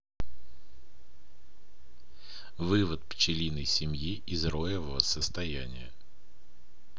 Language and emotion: Russian, neutral